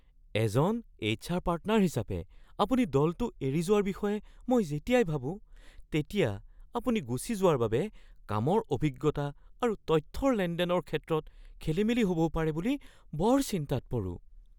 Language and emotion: Assamese, fearful